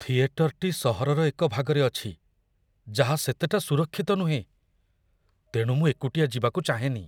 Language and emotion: Odia, fearful